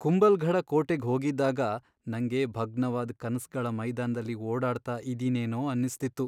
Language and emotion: Kannada, sad